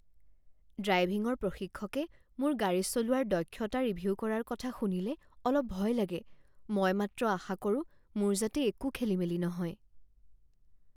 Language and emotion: Assamese, fearful